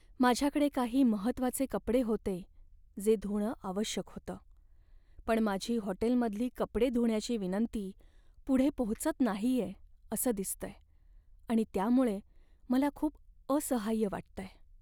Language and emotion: Marathi, sad